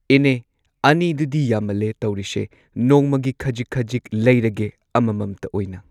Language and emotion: Manipuri, neutral